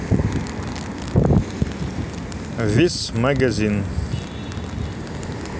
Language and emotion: Russian, neutral